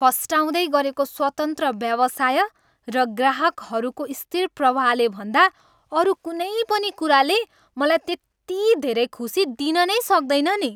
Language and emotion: Nepali, happy